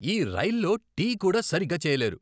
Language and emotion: Telugu, angry